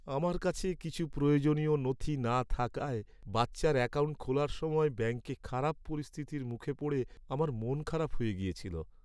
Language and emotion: Bengali, sad